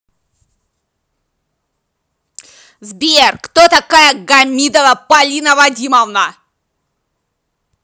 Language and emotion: Russian, angry